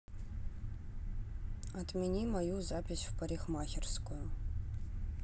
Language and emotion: Russian, neutral